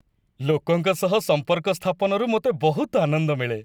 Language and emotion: Odia, happy